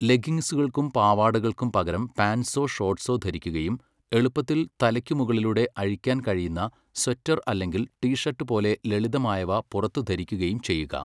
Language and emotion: Malayalam, neutral